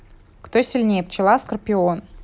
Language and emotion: Russian, neutral